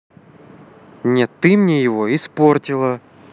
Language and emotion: Russian, angry